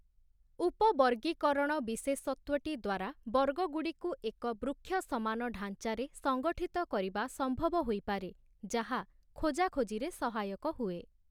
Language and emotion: Odia, neutral